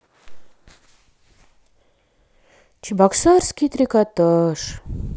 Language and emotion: Russian, sad